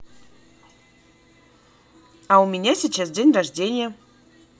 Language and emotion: Russian, positive